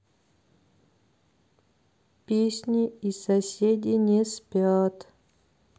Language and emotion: Russian, neutral